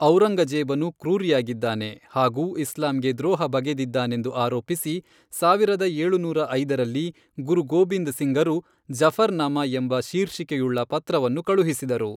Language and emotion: Kannada, neutral